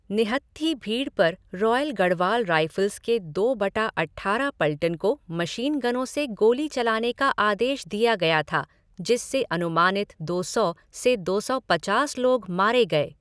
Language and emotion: Hindi, neutral